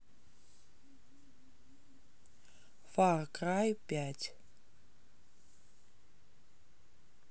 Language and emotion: Russian, neutral